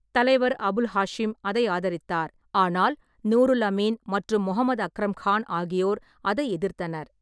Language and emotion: Tamil, neutral